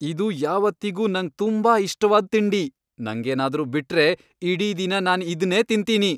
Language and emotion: Kannada, happy